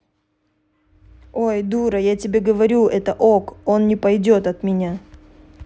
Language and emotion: Russian, neutral